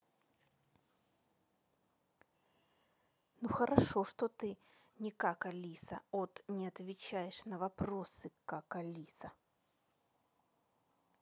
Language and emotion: Russian, angry